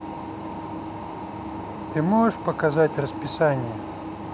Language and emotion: Russian, neutral